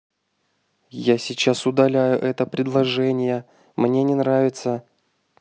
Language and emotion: Russian, angry